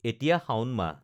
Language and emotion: Assamese, neutral